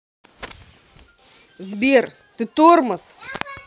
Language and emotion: Russian, angry